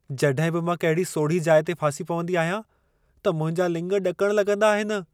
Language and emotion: Sindhi, fearful